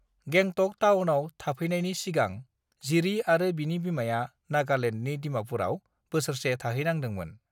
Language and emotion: Bodo, neutral